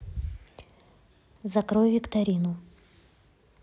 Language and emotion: Russian, neutral